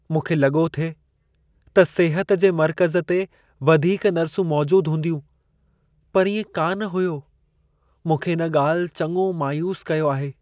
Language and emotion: Sindhi, sad